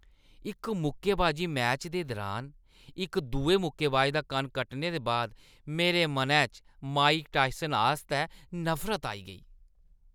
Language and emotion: Dogri, disgusted